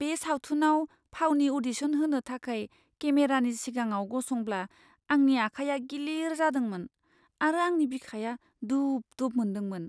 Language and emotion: Bodo, fearful